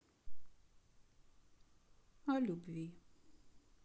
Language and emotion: Russian, sad